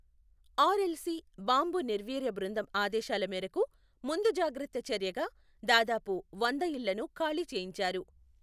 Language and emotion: Telugu, neutral